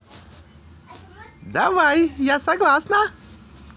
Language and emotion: Russian, positive